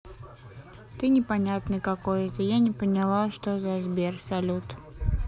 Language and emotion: Russian, sad